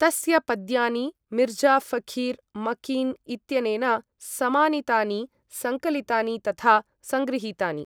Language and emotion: Sanskrit, neutral